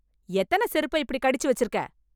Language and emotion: Tamil, angry